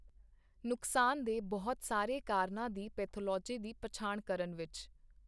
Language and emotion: Punjabi, neutral